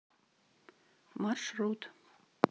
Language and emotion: Russian, neutral